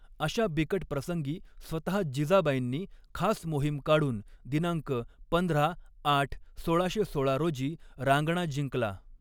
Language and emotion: Marathi, neutral